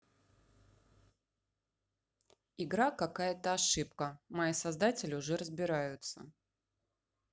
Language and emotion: Russian, neutral